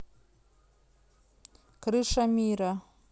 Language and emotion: Russian, neutral